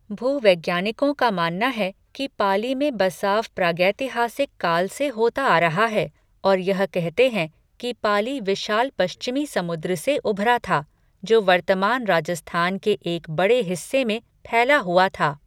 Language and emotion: Hindi, neutral